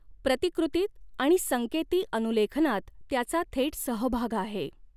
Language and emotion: Marathi, neutral